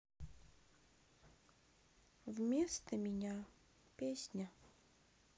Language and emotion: Russian, sad